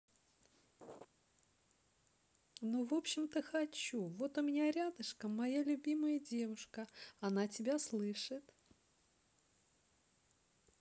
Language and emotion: Russian, neutral